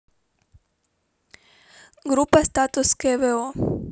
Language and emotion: Russian, neutral